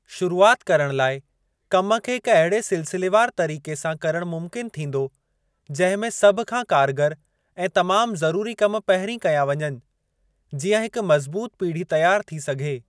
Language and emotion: Sindhi, neutral